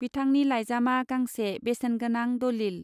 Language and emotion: Bodo, neutral